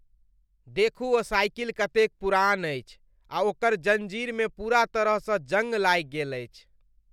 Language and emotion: Maithili, disgusted